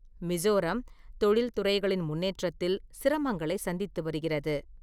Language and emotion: Tamil, neutral